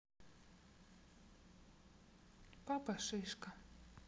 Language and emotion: Russian, neutral